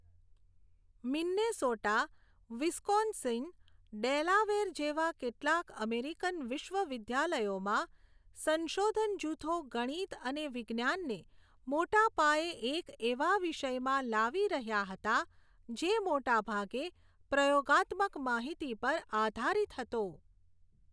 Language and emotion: Gujarati, neutral